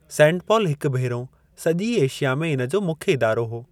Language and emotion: Sindhi, neutral